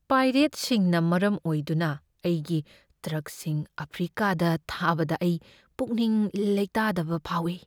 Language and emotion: Manipuri, fearful